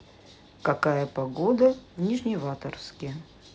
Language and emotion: Russian, neutral